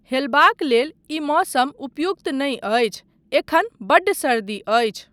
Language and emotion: Maithili, neutral